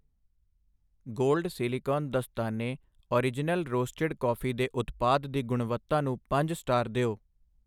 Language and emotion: Punjabi, neutral